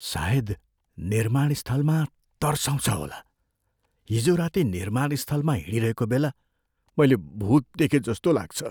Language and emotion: Nepali, fearful